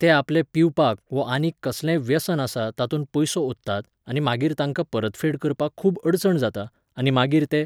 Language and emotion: Goan Konkani, neutral